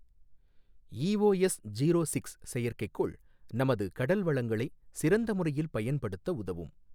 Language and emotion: Tamil, neutral